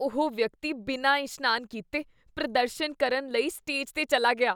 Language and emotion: Punjabi, disgusted